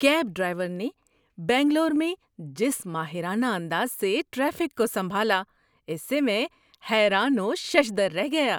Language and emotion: Urdu, surprised